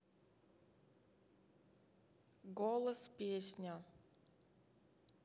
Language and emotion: Russian, neutral